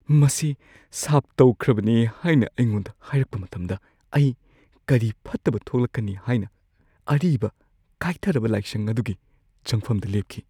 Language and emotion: Manipuri, fearful